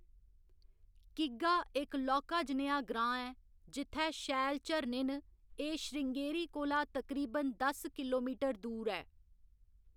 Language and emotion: Dogri, neutral